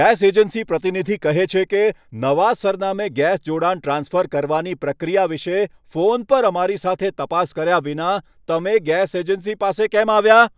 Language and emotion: Gujarati, angry